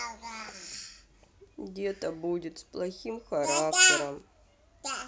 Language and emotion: Russian, sad